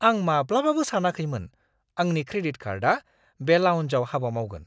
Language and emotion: Bodo, surprised